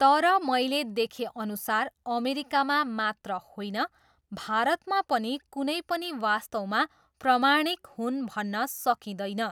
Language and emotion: Nepali, neutral